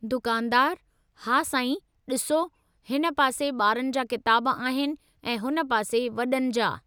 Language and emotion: Sindhi, neutral